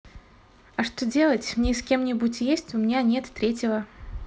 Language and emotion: Russian, neutral